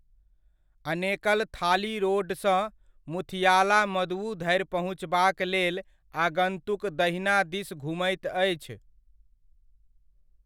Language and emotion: Maithili, neutral